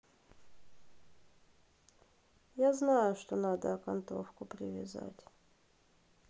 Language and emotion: Russian, sad